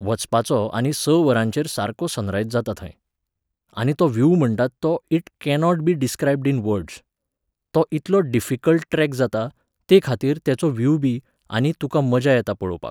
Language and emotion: Goan Konkani, neutral